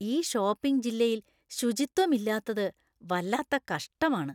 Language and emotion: Malayalam, disgusted